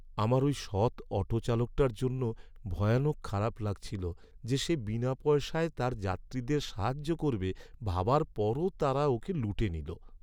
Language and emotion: Bengali, sad